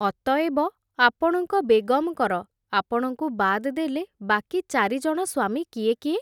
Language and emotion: Odia, neutral